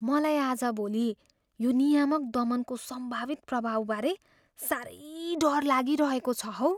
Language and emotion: Nepali, fearful